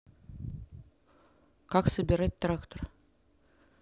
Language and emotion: Russian, neutral